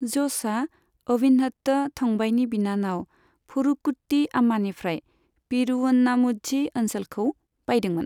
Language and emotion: Bodo, neutral